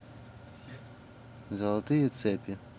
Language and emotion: Russian, neutral